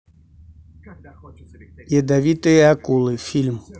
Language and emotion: Russian, neutral